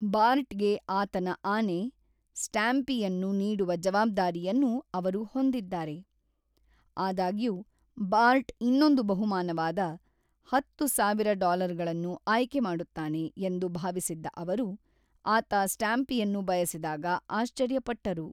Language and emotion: Kannada, neutral